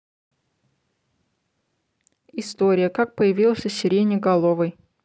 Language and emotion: Russian, neutral